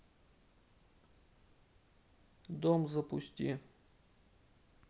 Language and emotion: Russian, neutral